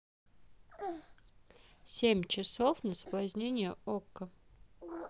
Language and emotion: Russian, neutral